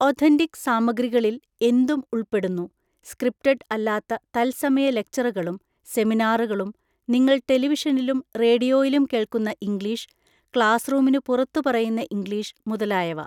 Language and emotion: Malayalam, neutral